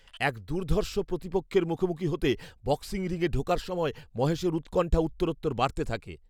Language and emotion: Bengali, fearful